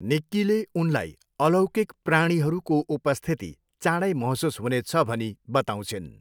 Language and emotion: Nepali, neutral